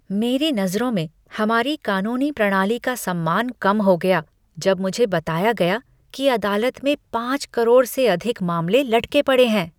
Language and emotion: Hindi, disgusted